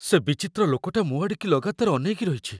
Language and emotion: Odia, fearful